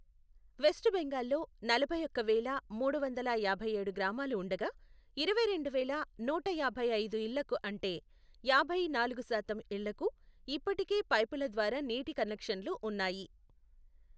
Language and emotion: Telugu, neutral